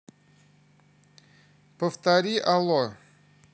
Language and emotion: Russian, neutral